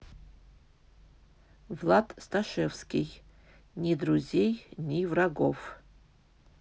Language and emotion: Russian, neutral